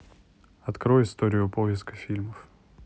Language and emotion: Russian, neutral